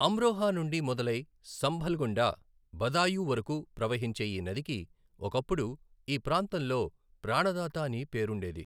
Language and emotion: Telugu, neutral